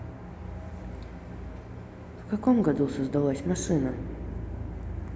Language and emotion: Russian, neutral